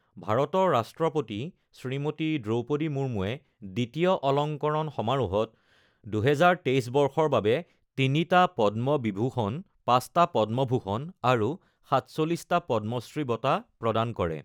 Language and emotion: Assamese, neutral